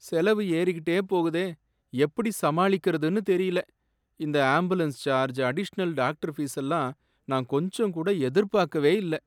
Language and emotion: Tamil, sad